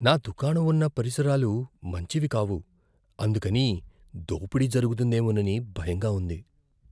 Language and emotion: Telugu, fearful